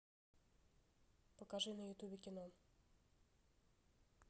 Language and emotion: Russian, neutral